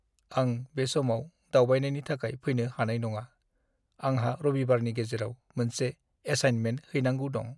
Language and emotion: Bodo, sad